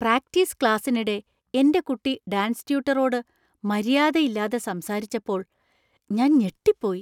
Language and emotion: Malayalam, surprised